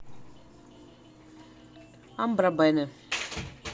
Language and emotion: Russian, neutral